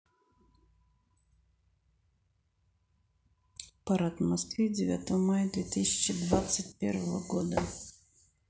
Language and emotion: Russian, neutral